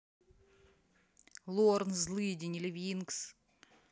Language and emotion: Russian, neutral